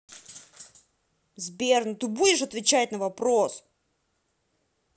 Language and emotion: Russian, angry